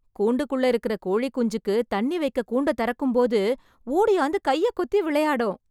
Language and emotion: Tamil, happy